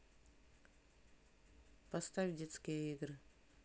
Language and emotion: Russian, neutral